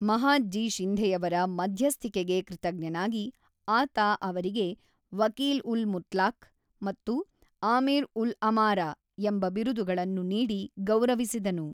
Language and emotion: Kannada, neutral